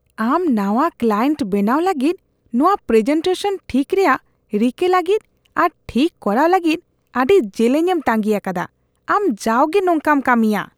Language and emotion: Santali, disgusted